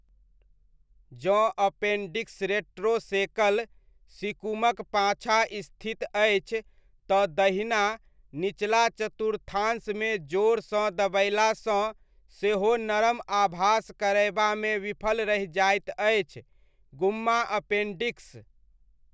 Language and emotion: Maithili, neutral